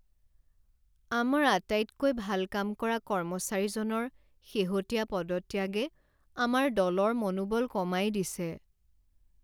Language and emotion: Assamese, sad